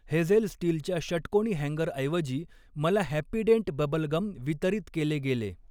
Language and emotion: Marathi, neutral